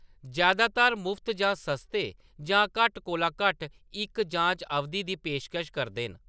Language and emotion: Dogri, neutral